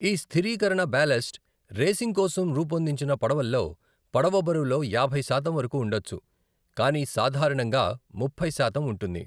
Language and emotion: Telugu, neutral